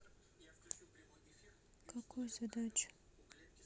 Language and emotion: Russian, neutral